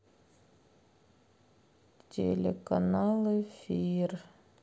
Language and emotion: Russian, sad